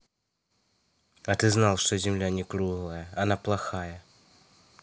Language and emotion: Russian, sad